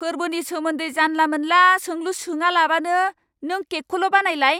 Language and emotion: Bodo, angry